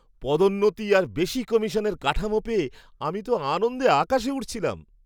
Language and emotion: Bengali, happy